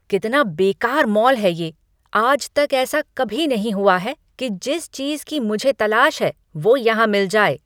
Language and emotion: Hindi, angry